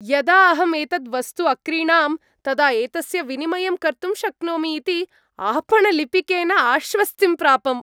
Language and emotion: Sanskrit, happy